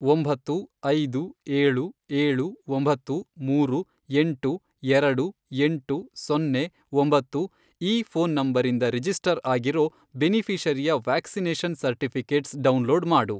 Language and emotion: Kannada, neutral